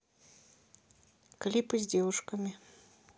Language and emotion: Russian, neutral